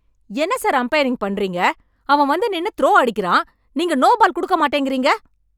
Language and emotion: Tamil, angry